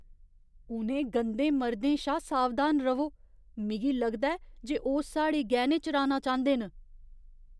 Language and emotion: Dogri, fearful